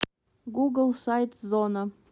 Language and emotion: Russian, neutral